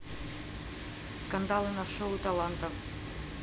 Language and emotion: Russian, neutral